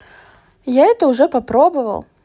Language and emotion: Russian, neutral